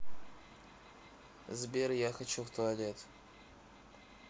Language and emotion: Russian, neutral